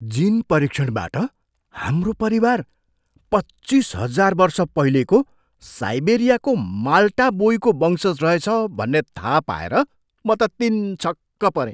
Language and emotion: Nepali, surprised